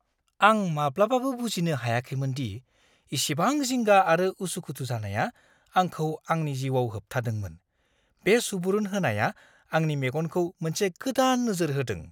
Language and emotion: Bodo, surprised